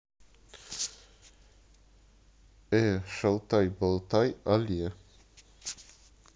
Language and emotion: Russian, neutral